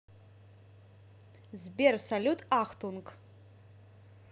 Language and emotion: Russian, neutral